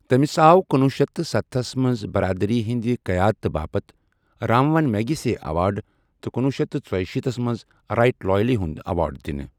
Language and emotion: Kashmiri, neutral